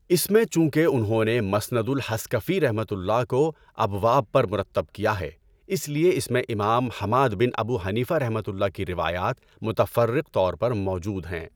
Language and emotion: Urdu, neutral